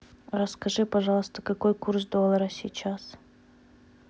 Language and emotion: Russian, neutral